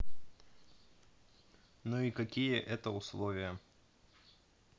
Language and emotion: Russian, neutral